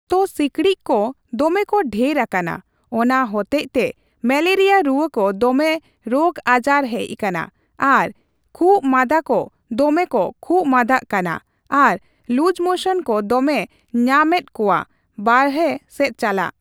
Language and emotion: Santali, neutral